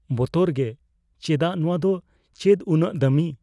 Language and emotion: Santali, fearful